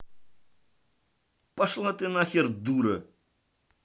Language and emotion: Russian, angry